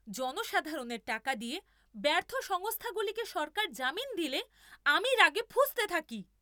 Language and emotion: Bengali, angry